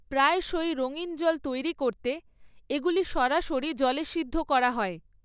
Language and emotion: Bengali, neutral